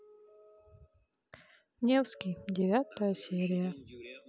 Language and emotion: Russian, sad